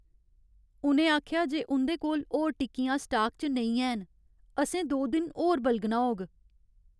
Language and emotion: Dogri, sad